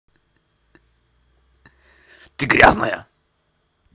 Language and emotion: Russian, angry